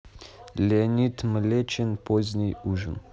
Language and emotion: Russian, neutral